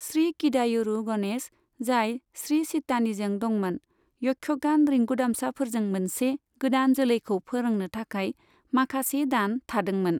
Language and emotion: Bodo, neutral